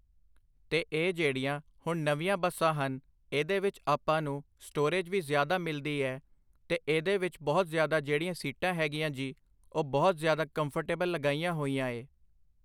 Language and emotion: Punjabi, neutral